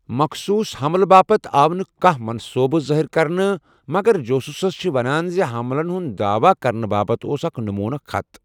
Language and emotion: Kashmiri, neutral